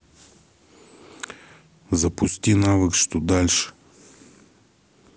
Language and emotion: Russian, neutral